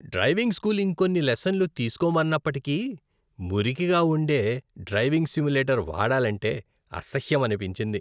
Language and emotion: Telugu, disgusted